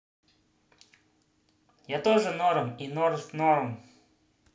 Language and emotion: Russian, positive